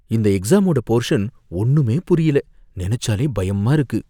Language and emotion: Tamil, fearful